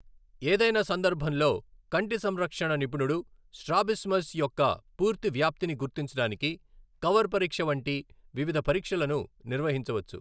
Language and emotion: Telugu, neutral